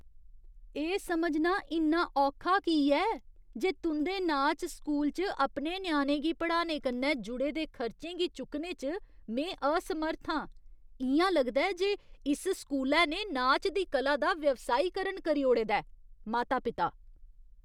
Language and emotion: Dogri, disgusted